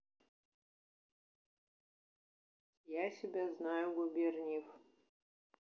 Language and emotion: Russian, neutral